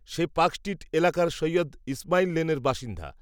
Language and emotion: Bengali, neutral